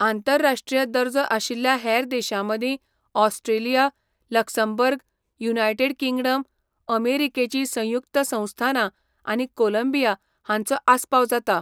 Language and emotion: Goan Konkani, neutral